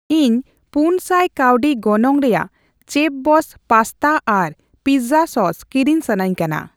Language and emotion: Santali, neutral